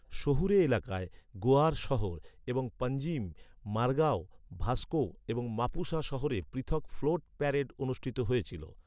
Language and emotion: Bengali, neutral